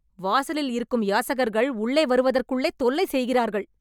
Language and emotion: Tamil, angry